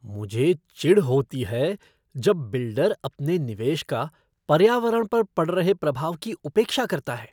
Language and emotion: Hindi, disgusted